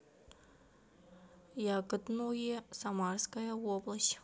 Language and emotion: Russian, neutral